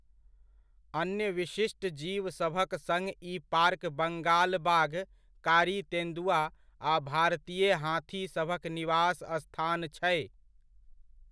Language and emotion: Maithili, neutral